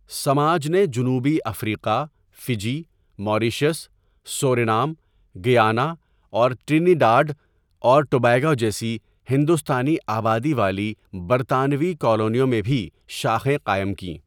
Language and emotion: Urdu, neutral